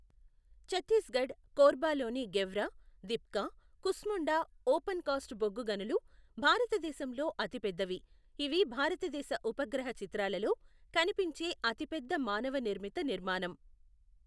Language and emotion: Telugu, neutral